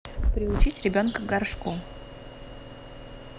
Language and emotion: Russian, neutral